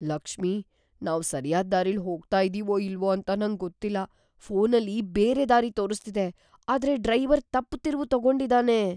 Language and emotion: Kannada, fearful